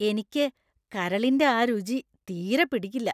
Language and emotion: Malayalam, disgusted